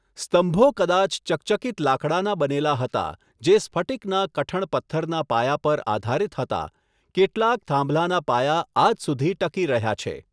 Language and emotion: Gujarati, neutral